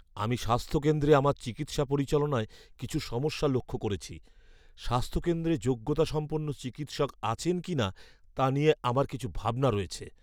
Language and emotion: Bengali, fearful